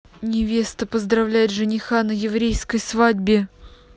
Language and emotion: Russian, angry